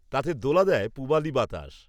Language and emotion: Bengali, neutral